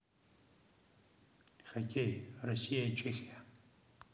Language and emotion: Russian, neutral